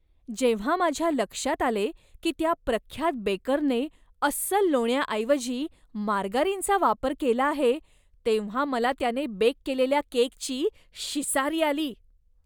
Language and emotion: Marathi, disgusted